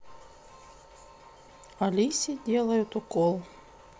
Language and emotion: Russian, neutral